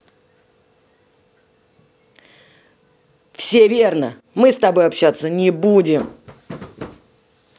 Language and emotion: Russian, angry